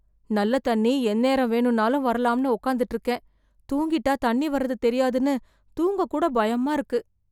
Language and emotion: Tamil, fearful